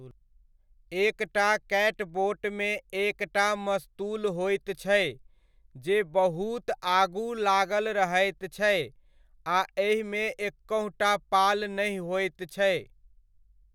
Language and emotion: Maithili, neutral